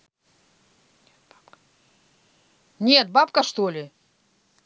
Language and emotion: Russian, angry